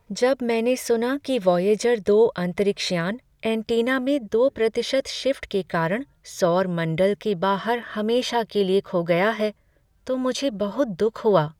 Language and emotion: Hindi, sad